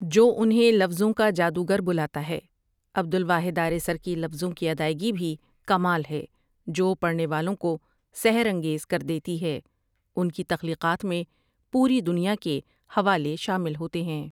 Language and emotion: Urdu, neutral